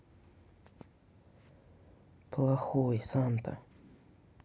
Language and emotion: Russian, sad